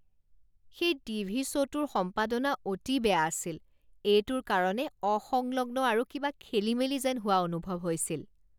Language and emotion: Assamese, disgusted